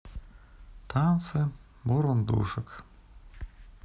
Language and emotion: Russian, neutral